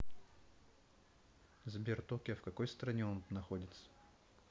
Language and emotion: Russian, neutral